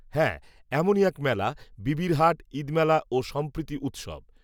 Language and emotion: Bengali, neutral